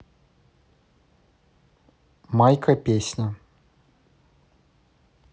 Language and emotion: Russian, neutral